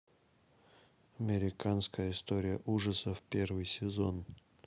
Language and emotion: Russian, neutral